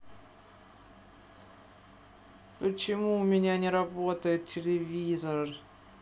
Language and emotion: Russian, sad